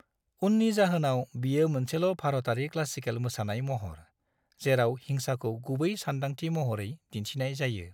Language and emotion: Bodo, neutral